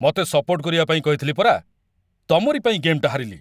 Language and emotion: Odia, angry